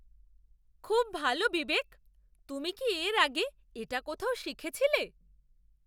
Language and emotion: Bengali, surprised